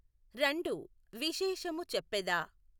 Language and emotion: Telugu, neutral